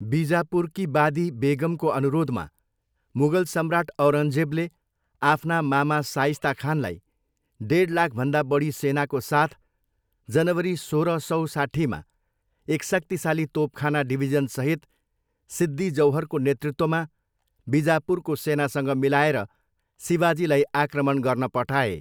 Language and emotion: Nepali, neutral